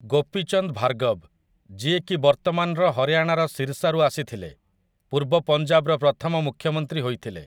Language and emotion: Odia, neutral